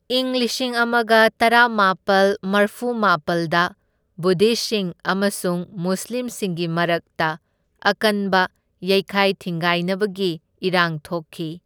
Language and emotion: Manipuri, neutral